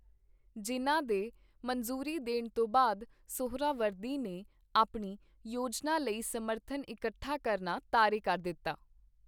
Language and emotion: Punjabi, neutral